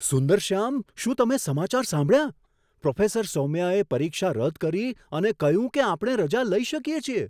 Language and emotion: Gujarati, surprised